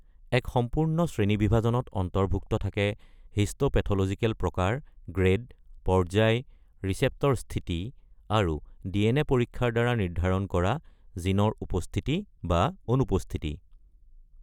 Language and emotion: Assamese, neutral